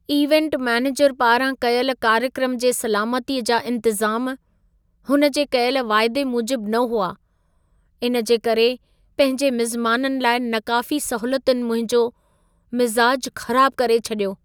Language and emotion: Sindhi, sad